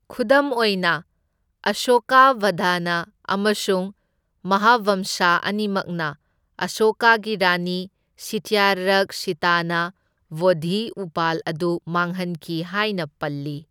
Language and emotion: Manipuri, neutral